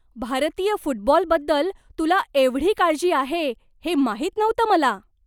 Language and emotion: Marathi, surprised